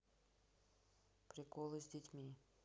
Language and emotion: Russian, neutral